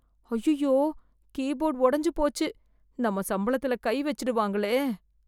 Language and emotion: Tamil, fearful